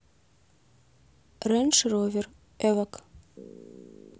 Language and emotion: Russian, neutral